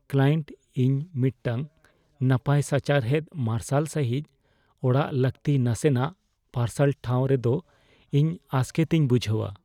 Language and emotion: Santali, fearful